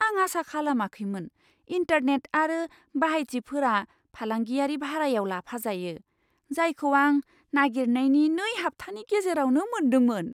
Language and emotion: Bodo, surprised